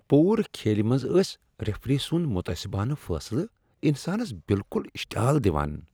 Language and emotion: Kashmiri, disgusted